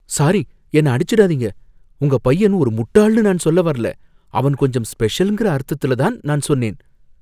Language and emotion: Tamil, fearful